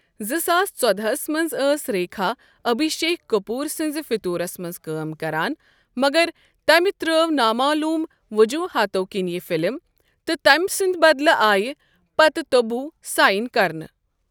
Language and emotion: Kashmiri, neutral